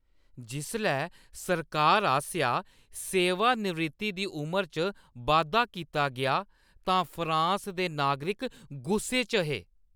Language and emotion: Dogri, angry